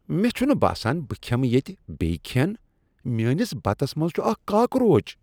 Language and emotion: Kashmiri, disgusted